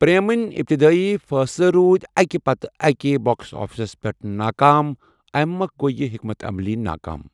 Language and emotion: Kashmiri, neutral